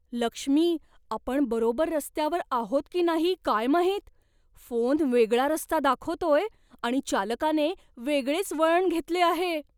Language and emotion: Marathi, fearful